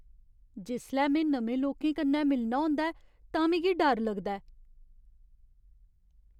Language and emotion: Dogri, fearful